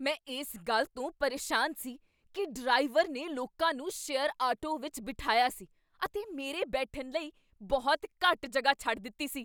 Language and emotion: Punjabi, angry